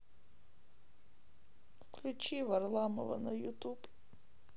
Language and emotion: Russian, sad